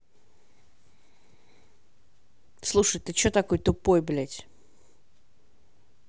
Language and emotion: Russian, angry